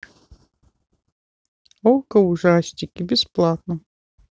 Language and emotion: Russian, neutral